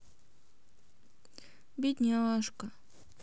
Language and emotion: Russian, sad